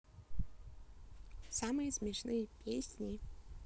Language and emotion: Russian, neutral